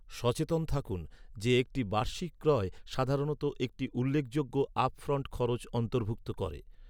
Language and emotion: Bengali, neutral